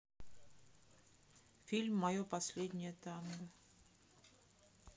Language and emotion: Russian, neutral